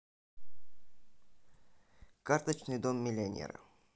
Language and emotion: Russian, neutral